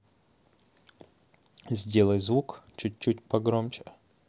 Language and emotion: Russian, neutral